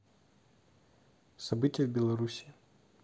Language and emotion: Russian, neutral